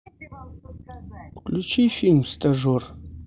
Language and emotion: Russian, neutral